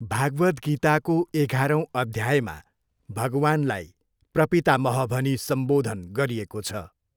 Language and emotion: Nepali, neutral